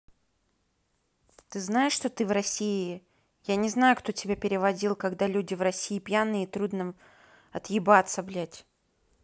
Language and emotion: Russian, neutral